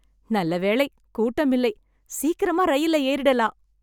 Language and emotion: Tamil, happy